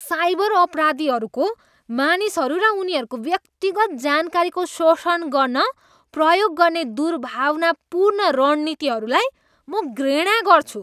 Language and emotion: Nepali, disgusted